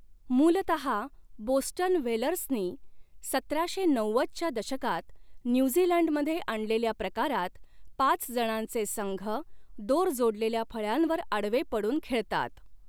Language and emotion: Marathi, neutral